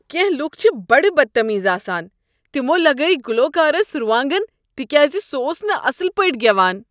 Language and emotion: Kashmiri, disgusted